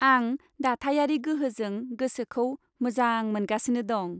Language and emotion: Bodo, happy